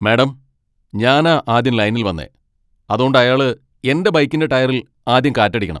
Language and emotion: Malayalam, angry